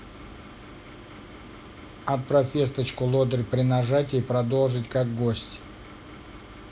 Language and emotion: Russian, neutral